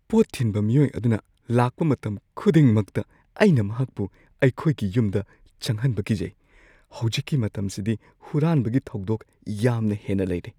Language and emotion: Manipuri, fearful